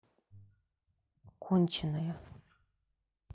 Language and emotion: Russian, neutral